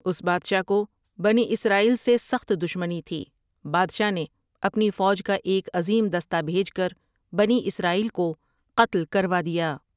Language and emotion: Urdu, neutral